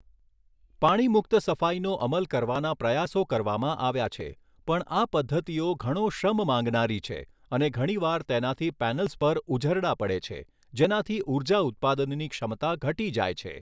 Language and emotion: Gujarati, neutral